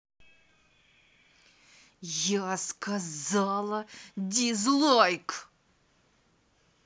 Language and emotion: Russian, angry